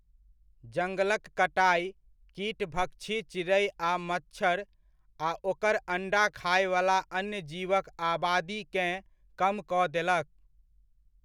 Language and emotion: Maithili, neutral